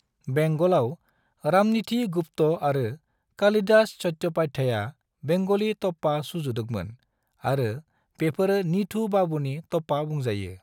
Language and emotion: Bodo, neutral